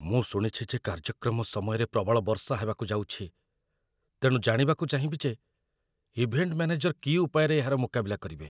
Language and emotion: Odia, fearful